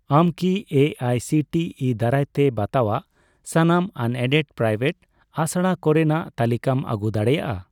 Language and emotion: Santali, neutral